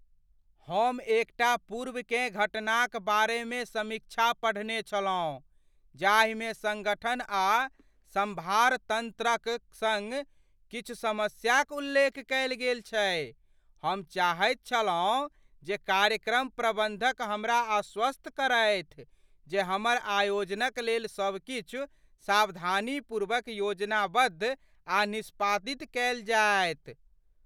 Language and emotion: Maithili, fearful